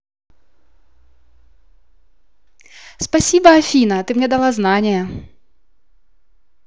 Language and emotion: Russian, positive